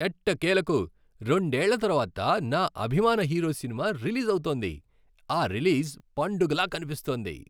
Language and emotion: Telugu, happy